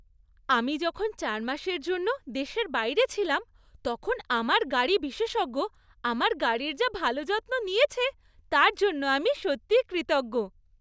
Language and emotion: Bengali, happy